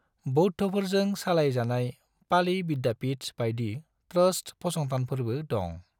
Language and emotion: Bodo, neutral